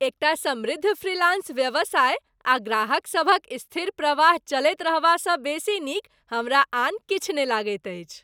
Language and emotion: Maithili, happy